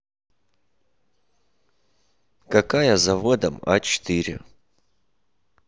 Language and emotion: Russian, neutral